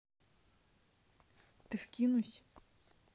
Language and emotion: Russian, neutral